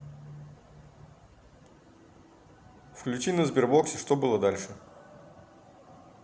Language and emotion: Russian, neutral